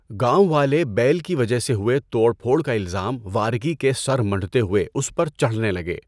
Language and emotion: Urdu, neutral